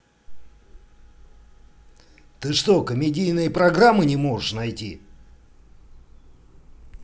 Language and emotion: Russian, angry